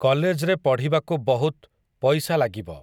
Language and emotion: Odia, neutral